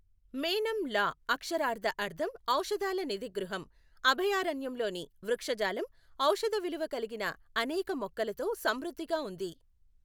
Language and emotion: Telugu, neutral